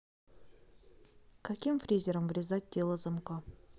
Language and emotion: Russian, neutral